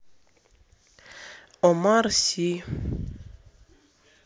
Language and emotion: Russian, neutral